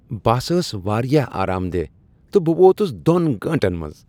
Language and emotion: Kashmiri, happy